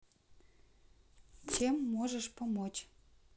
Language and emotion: Russian, neutral